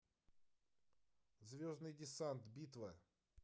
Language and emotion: Russian, neutral